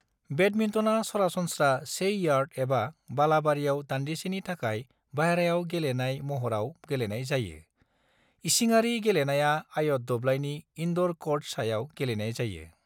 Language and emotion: Bodo, neutral